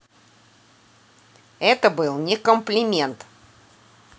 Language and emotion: Russian, neutral